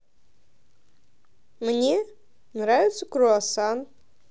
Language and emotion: Russian, positive